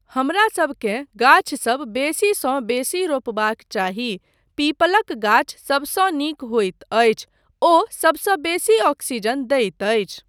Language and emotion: Maithili, neutral